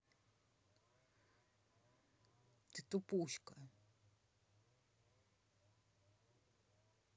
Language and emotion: Russian, neutral